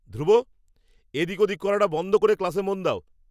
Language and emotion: Bengali, angry